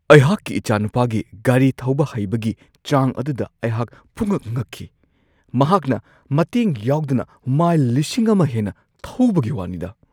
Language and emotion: Manipuri, surprised